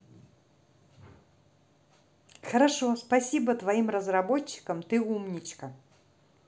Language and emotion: Russian, positive